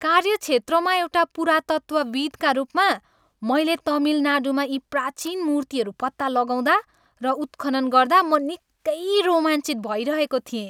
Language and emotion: Nepali, happy